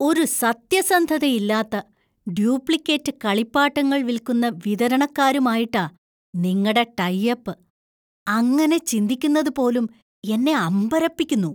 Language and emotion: Malayalam, disgusted